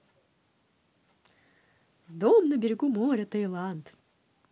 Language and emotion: Russian, positive